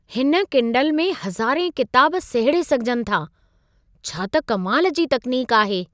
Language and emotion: Sindhi, surprised